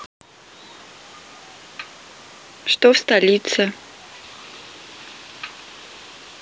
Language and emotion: Russian, neutral